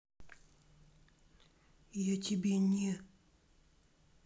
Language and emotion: Russian, angry